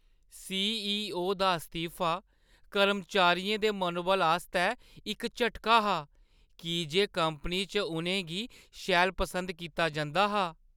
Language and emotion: Dogri, sad